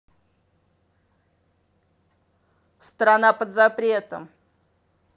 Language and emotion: Russian, angry